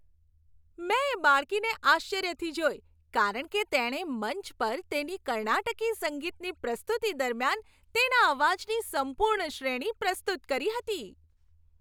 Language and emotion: Gujarati, happy